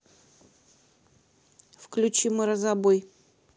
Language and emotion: Russian, neutral